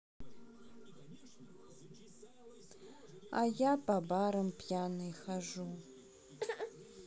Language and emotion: Russian, sad